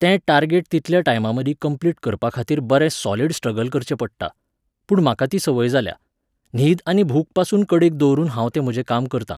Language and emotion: Goan Konkani, neutral